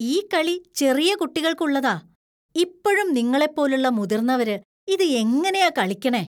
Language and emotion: Malayalam, disgusted